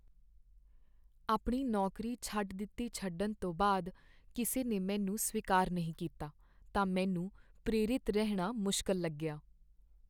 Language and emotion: Punjabi, sad